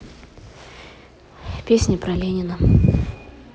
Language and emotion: Russian, neutral